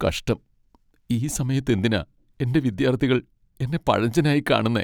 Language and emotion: Malayalam, sad